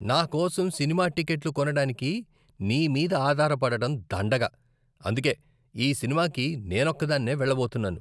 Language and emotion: Telugu, disgusted